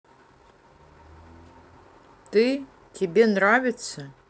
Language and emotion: Russian, neutral